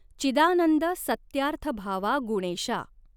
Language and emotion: Marathi, neutral